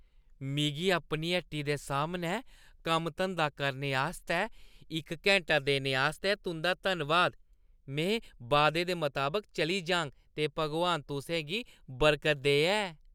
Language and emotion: Dogri, happy